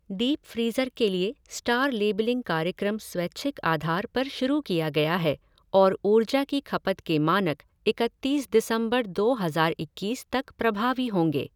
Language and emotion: Hindi, neutral